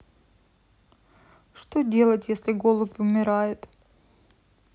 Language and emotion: Russian, sad